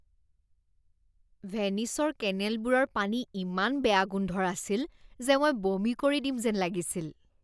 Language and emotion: Assamese, disgusted